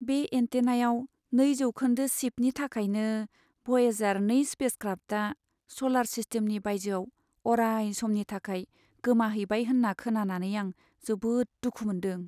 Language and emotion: Bodo, sad